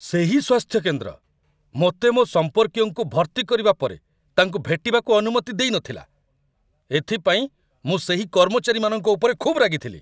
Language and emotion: Odia, angry